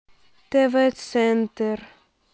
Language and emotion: Russian, neutral